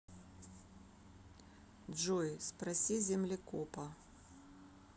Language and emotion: Russian, neutral